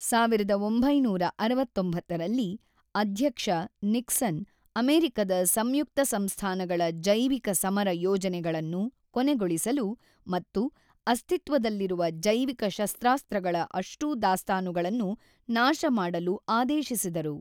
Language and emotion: Kannada, neutral